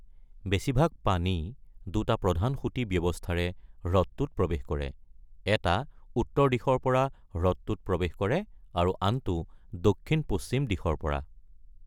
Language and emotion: Assamese, neutral